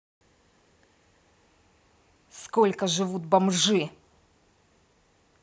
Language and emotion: Russian, angry